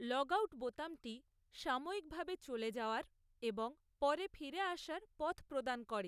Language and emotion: Bengali, neutral